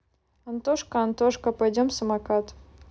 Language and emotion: Russian, neutral